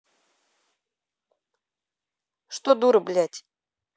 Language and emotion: Russian, angry